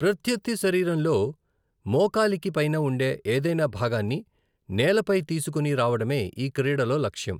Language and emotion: Telugu, neutral